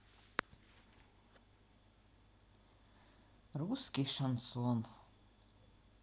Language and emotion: Russian, neutral